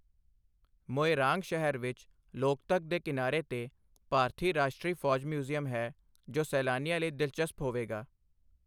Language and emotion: Punjabi, neutral